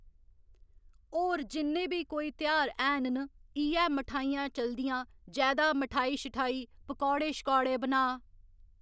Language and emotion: Dogri, neutral